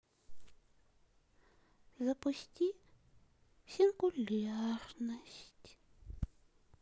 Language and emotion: Russian, sad